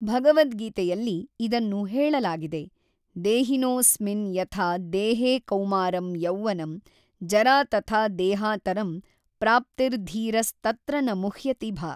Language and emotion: Kannada, neutral